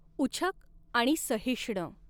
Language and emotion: Marathi, neutral